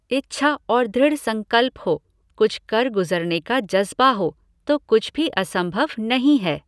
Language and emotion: Hindi, neutral